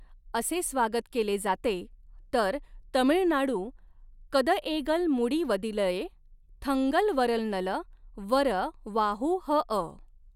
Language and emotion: Marathi, neutral